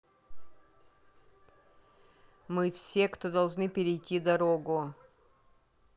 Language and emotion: Russian, neutral